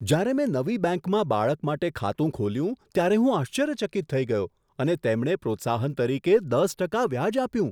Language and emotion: Gujarati, surprised